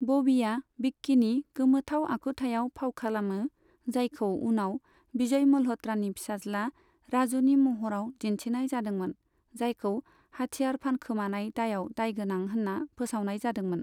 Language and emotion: Bodo, neutral